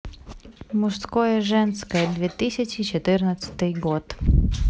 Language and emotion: Russian, neutral